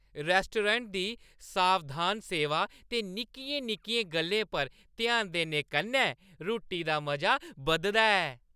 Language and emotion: Dogri, happy